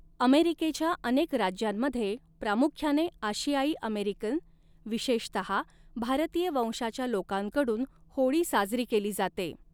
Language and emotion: Marathi, neutral